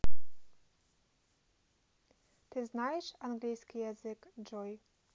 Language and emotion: Russian, neutral